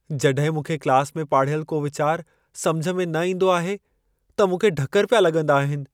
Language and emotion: Sindhi, fearful